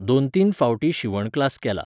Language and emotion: Goan Konkani, neutral